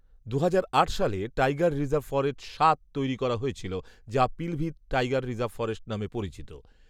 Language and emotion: Bengali, neutral